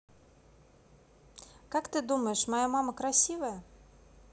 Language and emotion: Russian, neutral